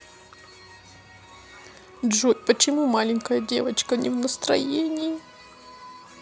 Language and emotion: Russian, sad